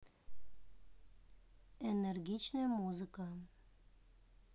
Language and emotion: Russian, neutral